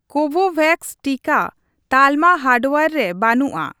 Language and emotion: Santali, neutral